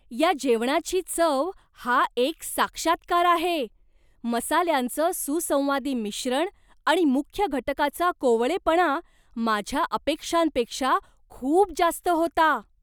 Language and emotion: Marathi, surprised